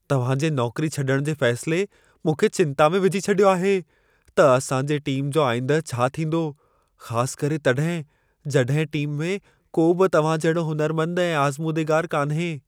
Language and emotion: Sindhi, fearful